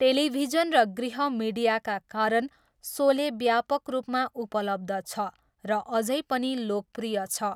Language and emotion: Nepali, neutral